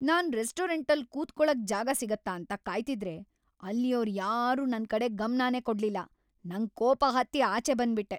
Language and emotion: Kannada, angry